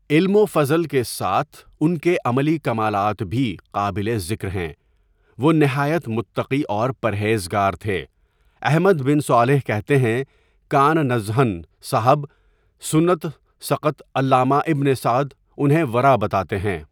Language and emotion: Urdu, neutral